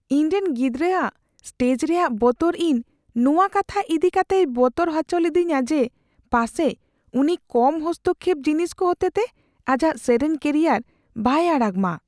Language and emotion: Santali, fearful